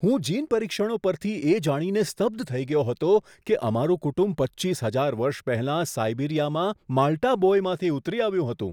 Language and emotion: Gujarati, surprised